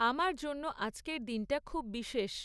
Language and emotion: Bengali, neutral